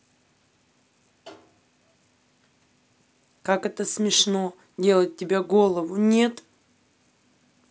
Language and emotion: Russian, angry